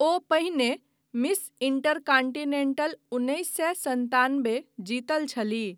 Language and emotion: Maithili, neutral